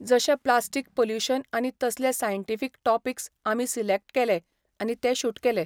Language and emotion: Goan Konkani, neutral